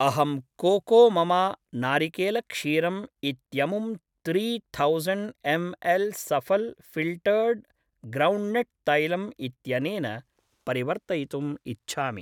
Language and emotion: Sanskrit, neutral